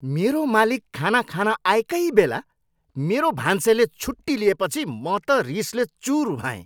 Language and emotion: Nepali, angry